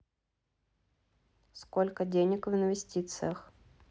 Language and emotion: Russian, neutral